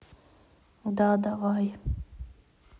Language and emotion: Russian, sad